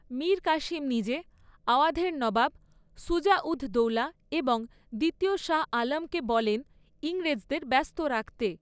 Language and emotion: Bengali, neutral